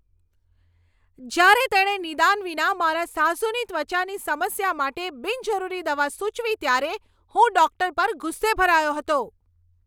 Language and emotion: Gujarati, angry